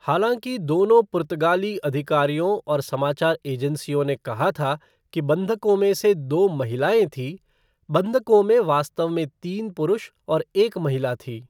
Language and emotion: Hindi, neutral